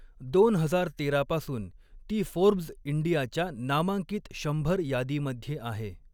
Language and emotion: Marathi, neutral